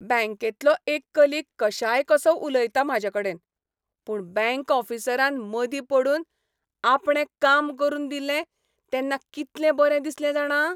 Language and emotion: Goan Konkani, happy